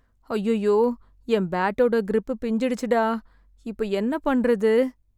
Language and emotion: Tamil, sad